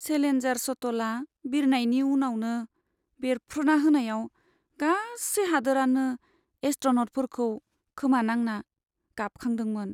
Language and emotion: Bodo, sad